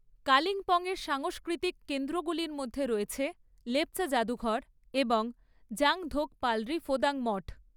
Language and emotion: Bengali, neutral